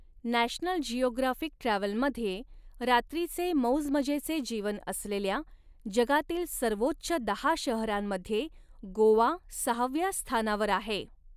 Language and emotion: Marathi, neutral